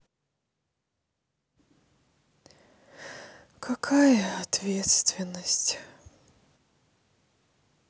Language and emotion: Russian, sad